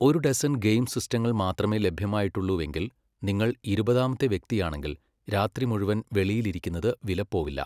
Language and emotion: Malayalam, neutral